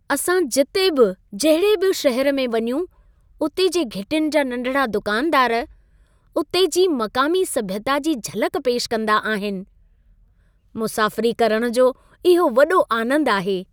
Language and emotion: Sindhi, happy